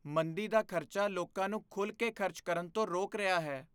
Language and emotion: Punjabi, fearful